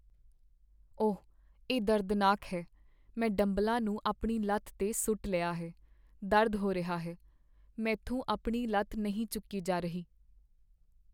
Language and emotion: Punjabi, sad